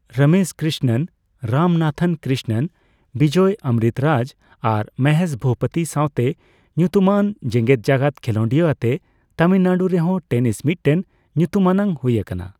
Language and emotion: Santali, neutral